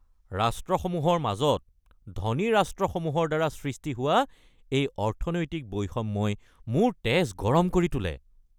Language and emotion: Assamese, angry